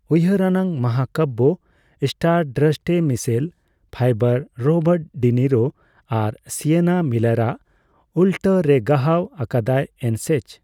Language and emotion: Santali, neutral